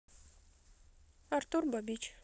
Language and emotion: Russian, neutral